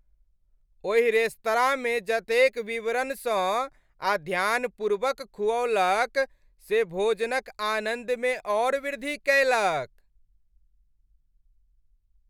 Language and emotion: Maithili, happy